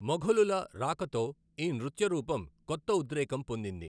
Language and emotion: Telugu, neutral